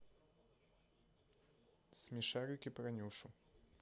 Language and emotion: Russian, neutral